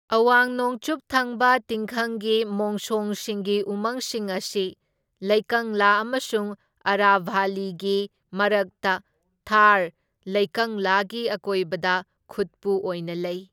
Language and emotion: Manipuri, neutral